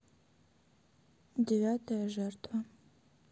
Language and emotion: Russian, neutral